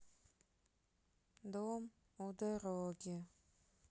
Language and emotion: Russian, sad